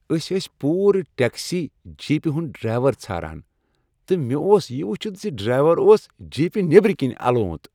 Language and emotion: Kashmiri, happy